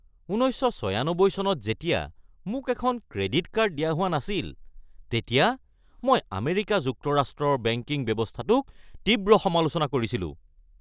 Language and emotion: Assamese, angry